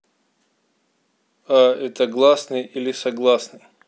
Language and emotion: Russian, neutral